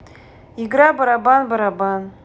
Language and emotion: Russian, neutral